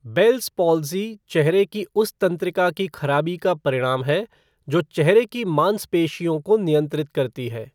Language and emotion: Hindi, neutral